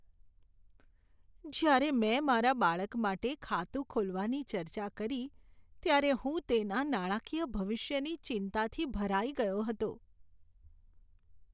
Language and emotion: Gujarati, sad